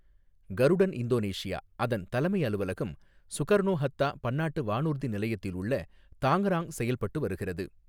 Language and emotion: Tamil, neutral